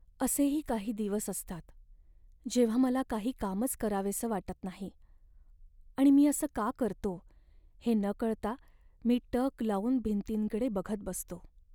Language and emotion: Marathi, sad